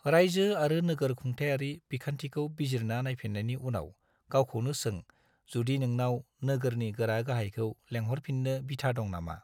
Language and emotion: Bodo, neutral